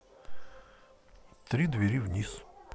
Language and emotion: Russian, neutral